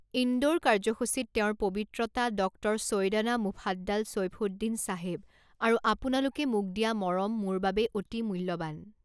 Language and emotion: Assamese, neutral